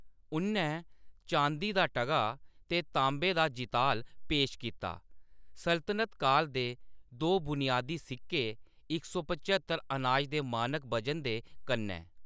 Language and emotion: Dogri, neutral